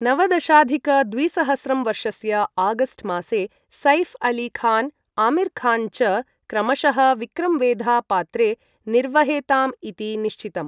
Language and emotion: Sanskrit, neutral